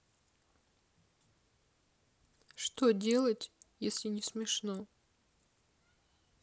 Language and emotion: Russian, sad